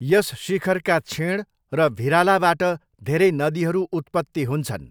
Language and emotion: Nepali, neutral